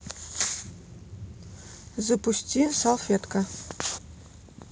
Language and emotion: Russian, neutral